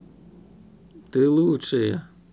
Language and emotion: Russian, positive